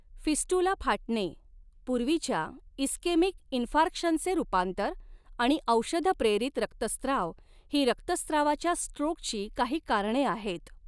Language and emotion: Marathi, neutral